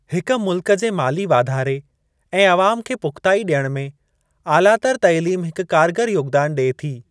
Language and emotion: Sindhi, neutral